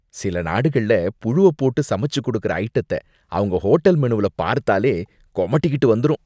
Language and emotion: Tamil, disgusted